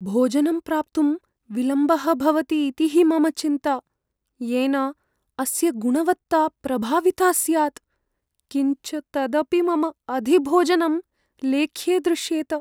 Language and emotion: Sanskrit, fearful